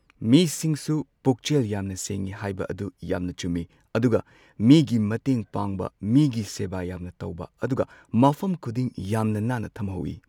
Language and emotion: Manipuri, neutral